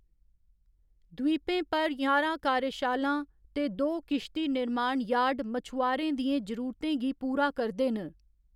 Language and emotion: Dogri, neutral